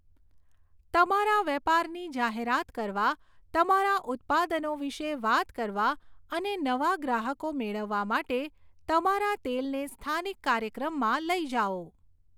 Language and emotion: Gujarati, neutral